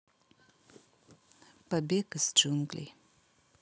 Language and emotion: Russian, neutral